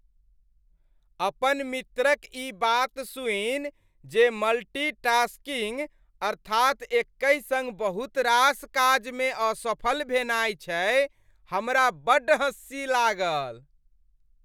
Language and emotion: Maithili, happy